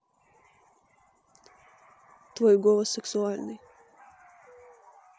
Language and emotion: Russian, neutral